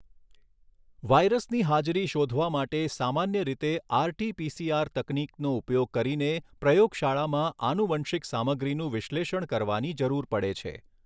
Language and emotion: Gujarati, neutral